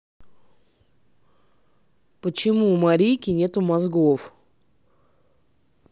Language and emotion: Russian, neutral